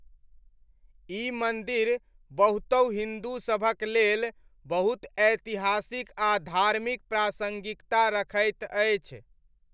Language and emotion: Maithili, neutral